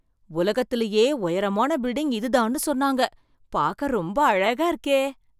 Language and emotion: Tamil, surprised